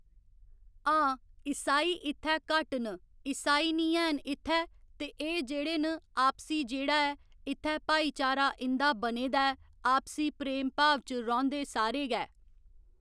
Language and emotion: Dogri, neutral